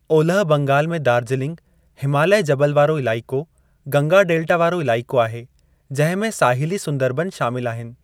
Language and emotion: Sindhi, neutral